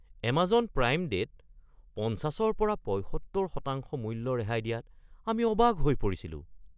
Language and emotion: Assamese, surprised